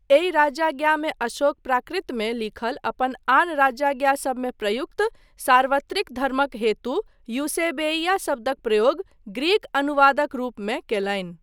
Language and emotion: Maithili, neutral